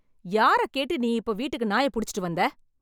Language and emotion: Tamil, angry